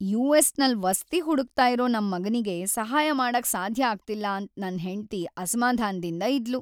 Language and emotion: Kannada, sad